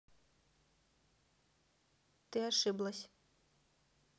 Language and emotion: Russian, neutral